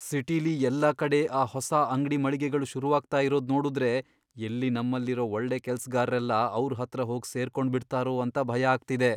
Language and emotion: Kannada, fearful